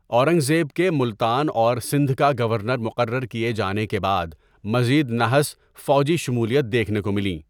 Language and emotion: Urdu, neutral